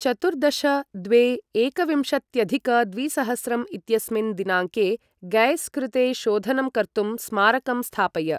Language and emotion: Sanskrit, neutral